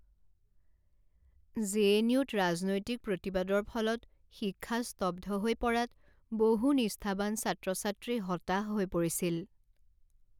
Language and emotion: Assamese, sad